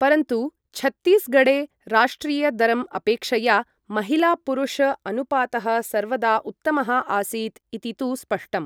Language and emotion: Sanskrit, neutral